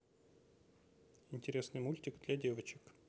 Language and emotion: Russian, neutral